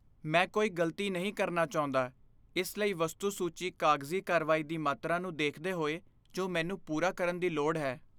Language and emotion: Punjabi, fearful